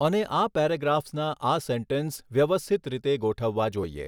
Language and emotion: Gujarati, neutral